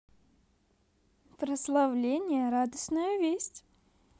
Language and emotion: Russian, positive